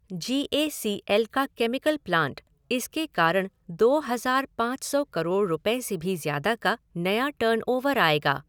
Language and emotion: Hindi, neutral